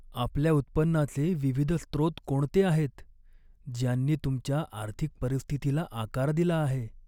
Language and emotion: Marathi, sad